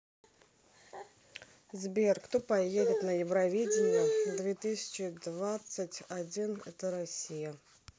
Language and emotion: Russian, neutral